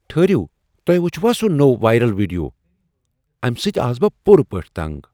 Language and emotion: Kashmiri, surprised